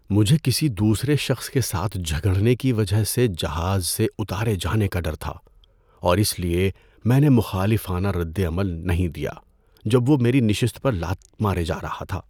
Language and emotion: Urdu, fearful